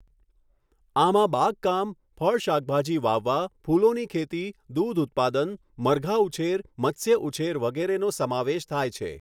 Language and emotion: Gujarati, neutral